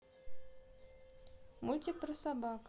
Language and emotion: Russian, neutral